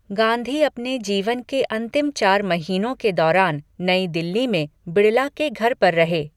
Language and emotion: Hindi, neutral